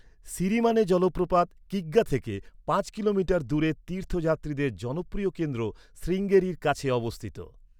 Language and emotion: Bengali, neutral